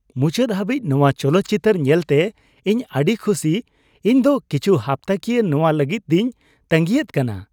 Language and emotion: Santali, happy